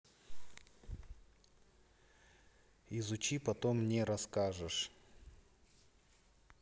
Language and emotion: Russian, neutral